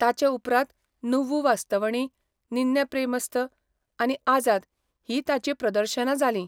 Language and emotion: Goan Konkani, neutral